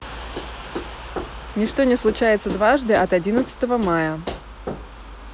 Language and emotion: Russian, neutral